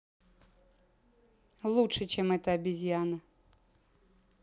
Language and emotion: Russian, neutral